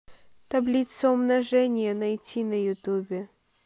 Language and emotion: Russian, neutral